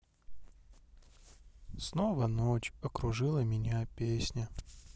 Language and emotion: Russian, sad